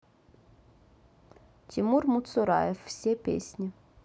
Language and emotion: Russian, neutral